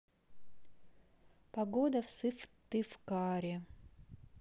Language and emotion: Russian, neutral